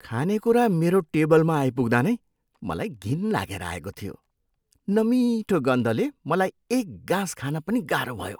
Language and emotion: Nepali, disgusted